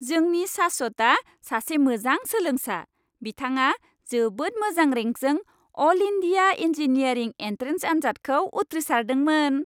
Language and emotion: Bodo, happy